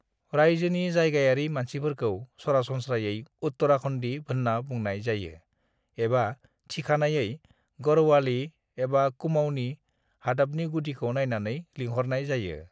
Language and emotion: Bodo, neutral